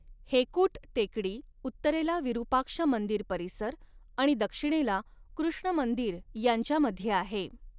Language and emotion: Marathi, neutral